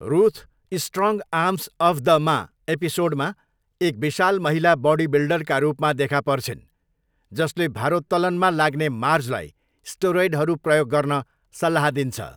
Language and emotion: Nepali, neutral